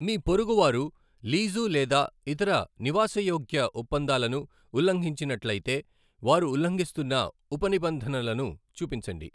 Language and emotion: Telugu, neutral